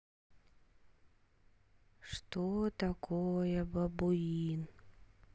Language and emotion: Russian, sad